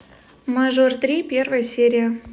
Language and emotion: Russian, neutral